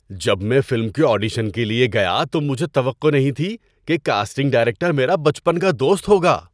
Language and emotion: Urdu, surprised